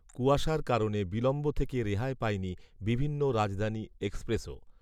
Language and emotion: Bengali, neutral